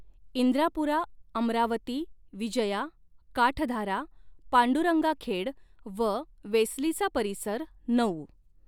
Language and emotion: Marathi, neutral